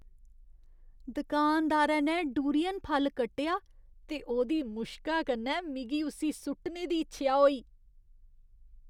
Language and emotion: Dogri, disgusted